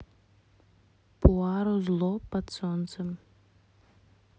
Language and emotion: Russian, neutral